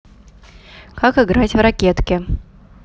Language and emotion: Russian, neutral